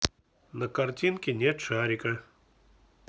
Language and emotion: Russian, neutral